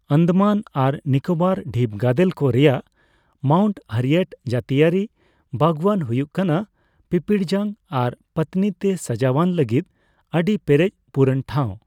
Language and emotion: Santali, neutral